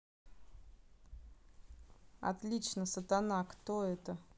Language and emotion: Russian, neutral